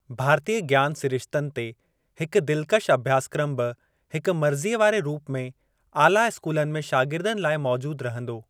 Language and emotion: Sindhi, neutral